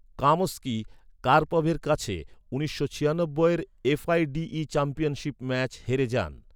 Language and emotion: Bengali, neutral